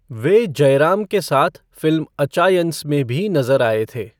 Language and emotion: Hindi, neutral